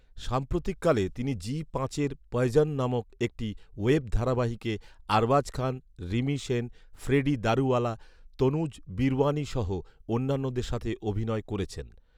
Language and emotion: Bengali, neutral